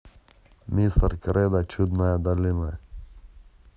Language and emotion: Russian, neutral